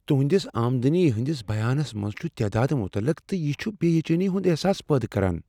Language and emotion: Kashmiri, fearful